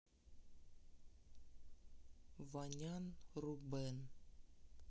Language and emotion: Russian, neutral